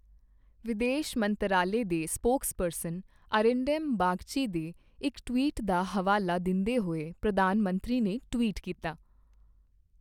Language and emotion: Punjabi, neutral